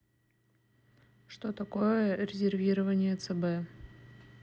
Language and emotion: Russian, neutral